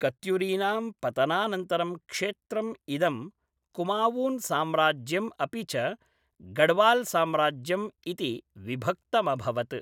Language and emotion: Sanskrit, neutral